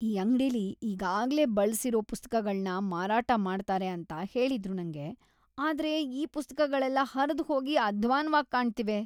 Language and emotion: Kannada, disgusted